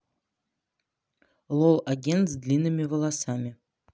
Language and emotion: Russian, neutral